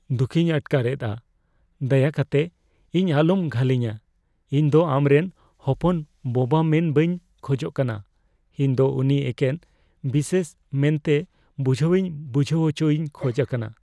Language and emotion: Santali, fearful